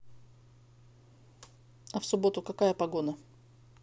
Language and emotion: Russian, positive